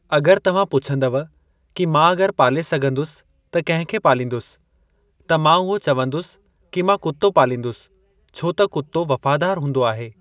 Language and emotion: Sindhi, neutral